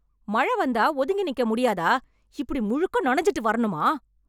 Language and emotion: Tamil, angry